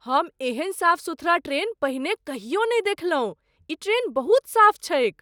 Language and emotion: Maithili, surprised